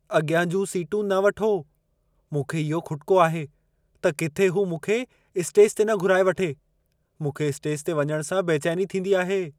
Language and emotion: Sindhi, fearful